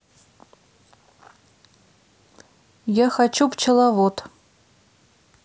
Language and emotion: Russian, neutral